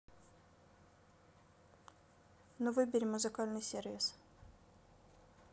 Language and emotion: Russian, neutral